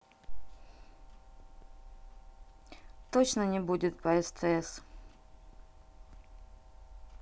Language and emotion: Russian, neutral